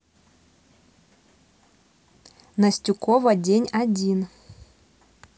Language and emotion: Russian, neutral